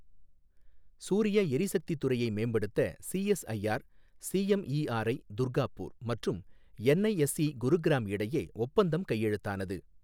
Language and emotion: Tamil, neutral